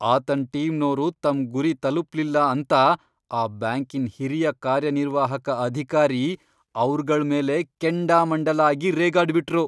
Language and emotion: Kannada, angry